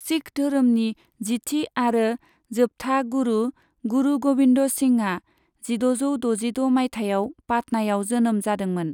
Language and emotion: Bodo, neutral